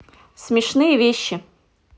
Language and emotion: Russian, neutral